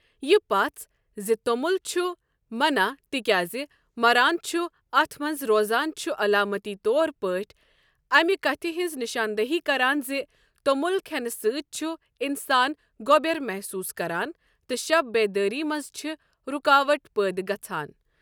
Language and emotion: Kashmiri, neutral